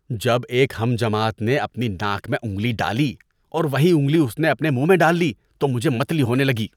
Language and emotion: Urdu, disgusted